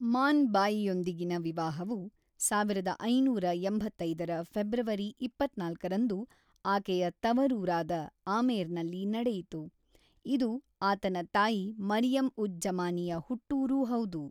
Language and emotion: Kannada, neutral